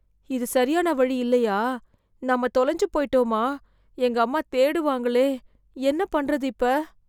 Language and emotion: Tamil, fearful